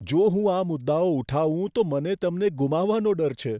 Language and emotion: Gujarati, fearful